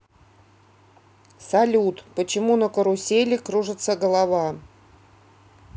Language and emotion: Russian, neutral